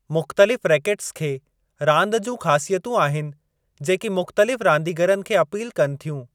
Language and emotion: Sindhi, neutral